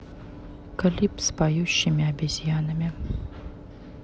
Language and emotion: Russian, neutral